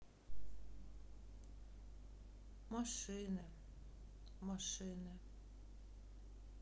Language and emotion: Russian, sad